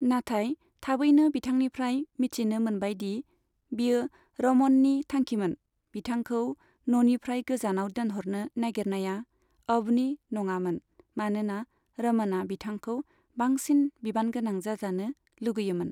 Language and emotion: Bodo, neutral